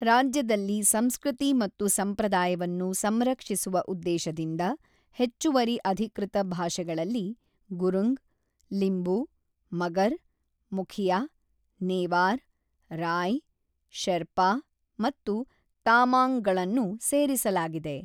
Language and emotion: Kannada, neutral